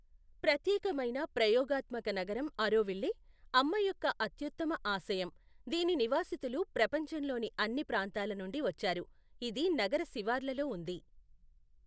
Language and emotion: Telugu, neutral